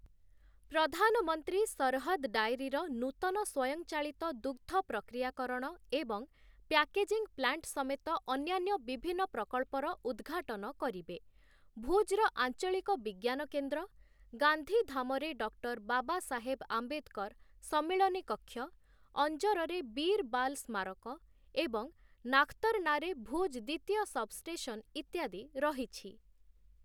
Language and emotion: Odia, neutral